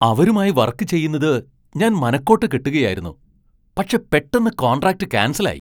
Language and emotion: Malayalam, surprised